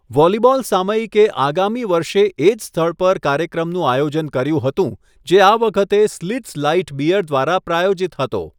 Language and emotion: Gujarati, neutral